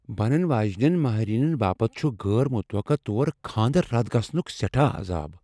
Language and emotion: Kashmiri, fearful